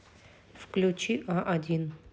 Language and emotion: Russian, neutral